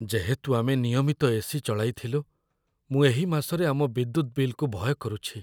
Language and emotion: Odia, fearful